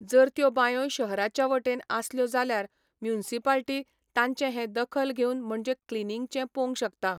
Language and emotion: Goan Konkani, neutral